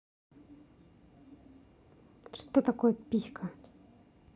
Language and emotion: Russian, angry